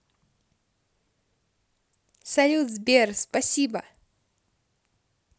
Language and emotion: Russian, positive